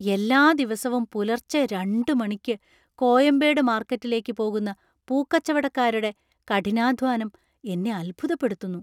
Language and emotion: Malayalam, surprised